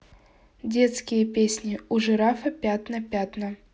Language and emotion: Russian, neutral